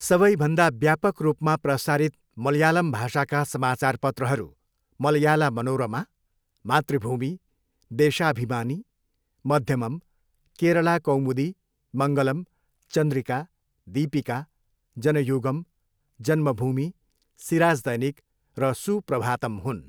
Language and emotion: Nepali, neutral